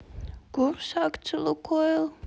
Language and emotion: Russian, sad